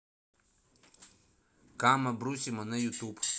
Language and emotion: Russian, neutral